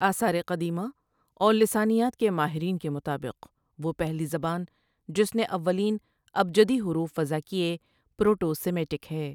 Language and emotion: Urdu, neutral